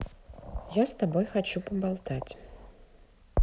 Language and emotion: Russian, neutral